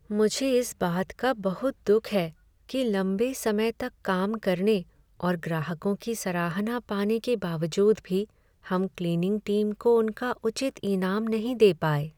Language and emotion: Hindi, sad